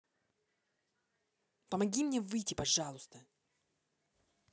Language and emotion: Russian, angry